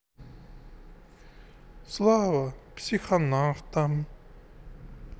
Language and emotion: Russian, sad